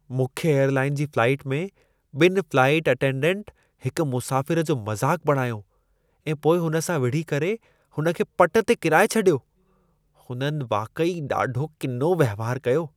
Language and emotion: Sindhi, disgusted